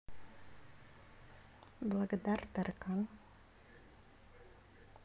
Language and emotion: Russian, neutral